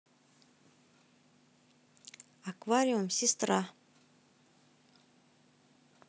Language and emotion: Russian, neutral